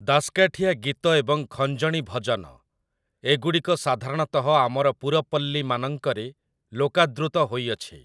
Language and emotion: Odia, neutral